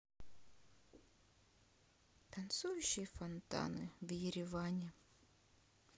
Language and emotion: Russian, sad